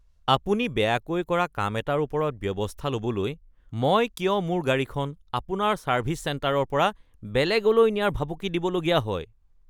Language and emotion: Assamese, disgusted